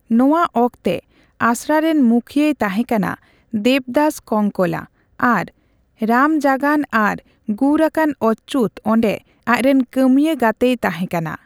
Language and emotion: Santali, neutral